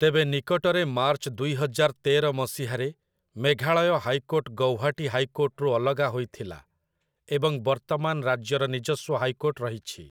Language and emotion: Odia, neutral